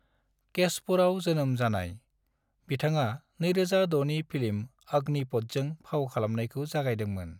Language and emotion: Bodo, neutral